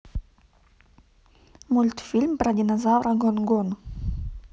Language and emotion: Russian, neutral